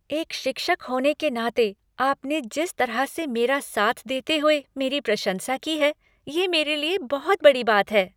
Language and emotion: Hindi, happy